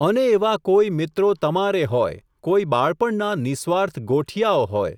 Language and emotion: Gujarati, neutral